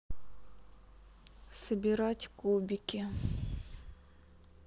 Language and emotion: Russian, sad